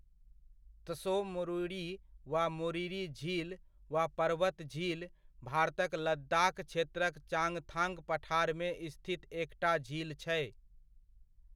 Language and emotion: Maithili, neutral